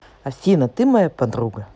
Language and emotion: Russian, positive